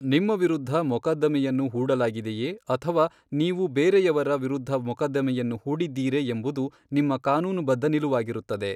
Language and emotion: Kannada, neutral